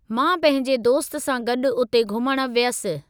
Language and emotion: Sindhi, neutral